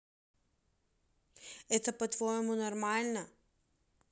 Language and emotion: Russian, angry